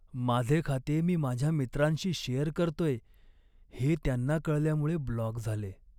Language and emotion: Marathi, sad